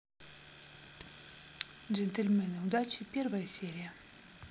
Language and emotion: Russian, neutral